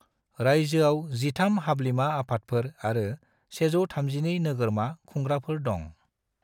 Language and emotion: Bodo, neutral